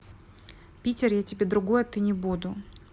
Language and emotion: Russian, neutral